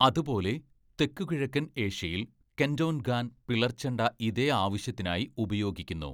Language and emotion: Malayalam, neutral